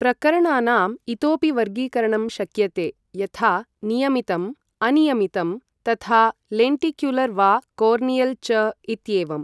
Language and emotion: Sanskrit, neutral